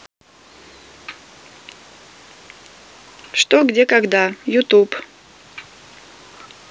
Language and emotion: Russian, neutral